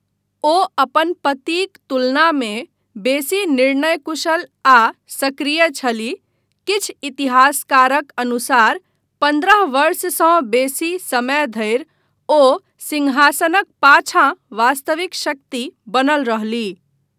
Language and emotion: Maithili, neutral